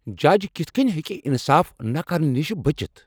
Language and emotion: Kashmiri, angry